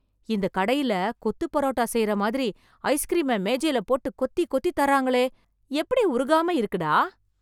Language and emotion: Tamil, surprised